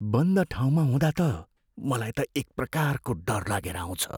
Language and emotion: Nepali, fearful